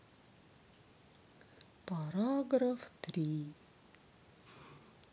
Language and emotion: Russian, sad